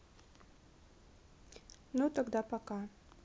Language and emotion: Russian, neutral